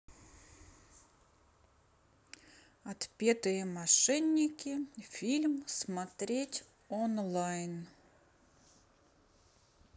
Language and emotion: Russian, neutral